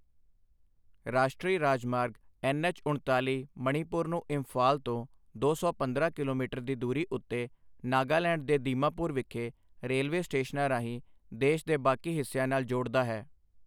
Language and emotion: Punjabi, neutral